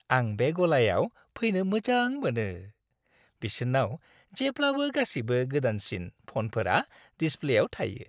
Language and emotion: Bodo, happy